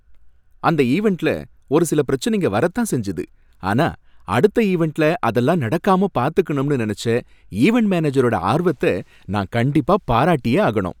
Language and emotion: Tamil, happy